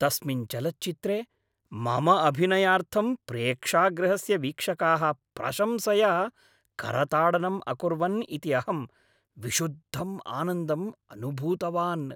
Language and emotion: Sanskrit, happy